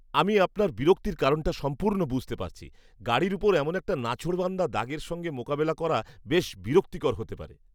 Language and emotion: Bengali, disgusted